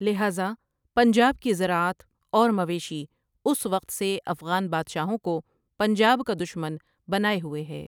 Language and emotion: Urdu, neutral